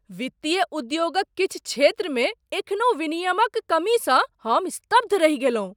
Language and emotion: Maithili, surprised